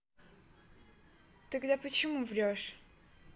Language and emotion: Russian, neutral